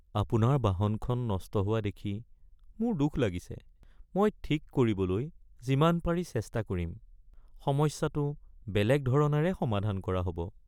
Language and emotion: Assamese, sad